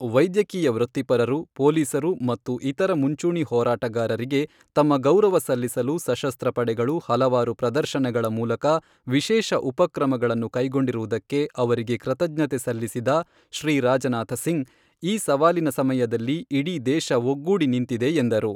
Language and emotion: Kannada, neutral